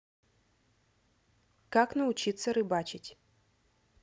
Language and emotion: Russian, neutral